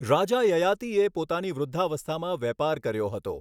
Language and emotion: Gujarati, neutral